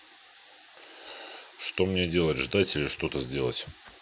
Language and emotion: Russian, neutral